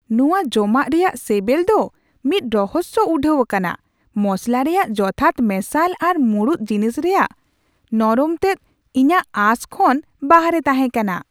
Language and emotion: Santali, surprised